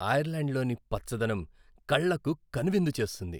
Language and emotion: Telugu, happy